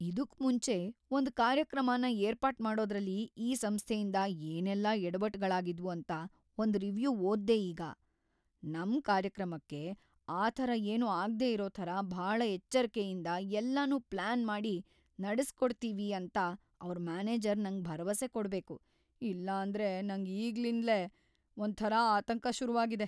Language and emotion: Kannada, fearful